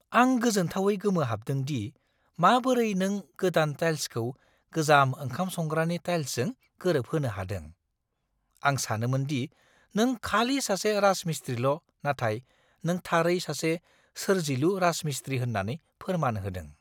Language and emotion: Bodo, surprised